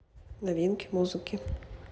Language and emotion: Russian, neutral